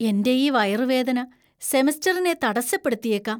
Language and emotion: Malayalam, fearful